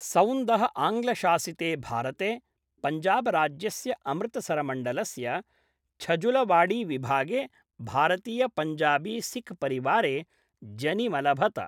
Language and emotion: Sanskrit, neutral